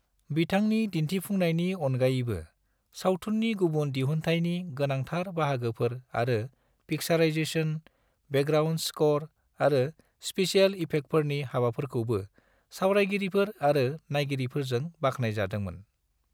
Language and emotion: Bodo, neutral